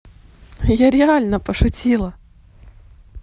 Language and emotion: Russian, positive